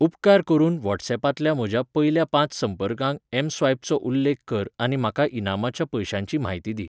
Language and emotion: Goan Konkani, neutral